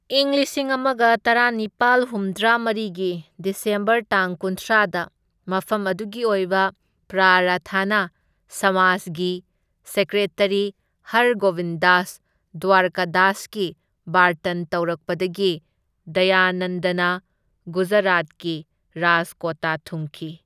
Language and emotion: Manipuri, neutral